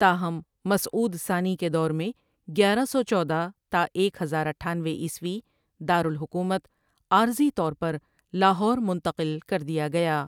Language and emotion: Urdu, neutral